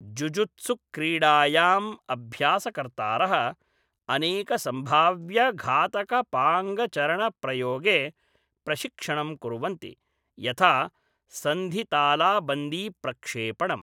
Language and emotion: Sanskrit, neutral